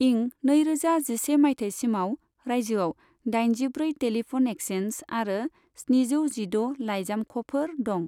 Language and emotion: Bodo, neutral